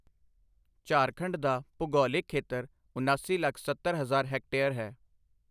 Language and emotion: Punjabi, neutral